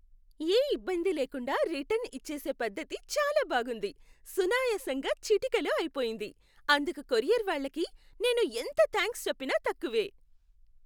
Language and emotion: Telugu, happy